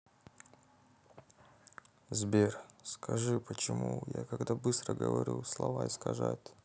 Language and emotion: Russian, sad